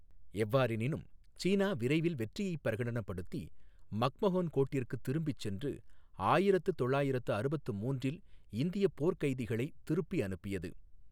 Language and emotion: Tamil, neutral